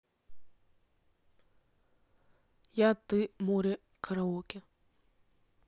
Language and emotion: Russian, neutral